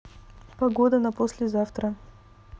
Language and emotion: Russian, neutral